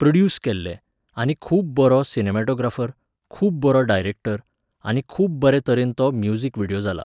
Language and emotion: Goan Konkani, neutral